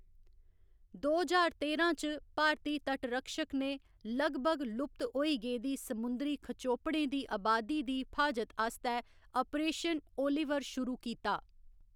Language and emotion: Dogri, neutral